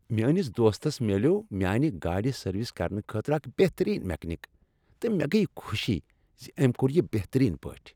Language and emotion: Kashmiri, happy